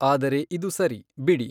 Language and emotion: Kannada, neutral